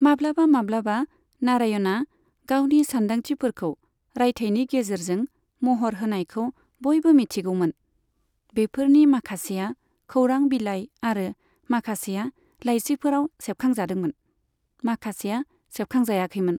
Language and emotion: Bodo, neutral